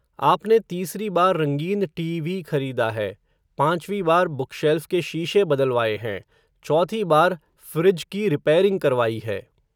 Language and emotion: Hindi, neutral